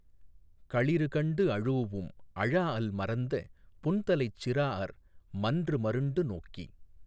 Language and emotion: Tamil, neutral